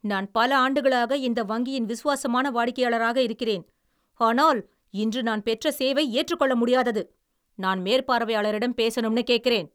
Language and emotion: Tamil, angry